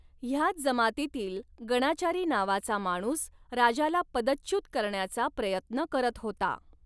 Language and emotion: Marathi, neutral